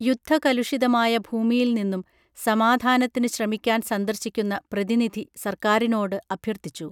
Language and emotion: Malayalam, neutral